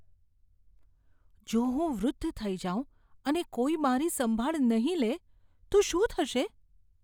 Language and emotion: Gujarati, fearful